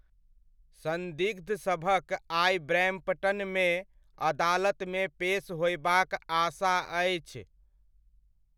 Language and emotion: Maithili, neutral